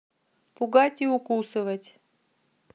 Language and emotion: Russian, neutral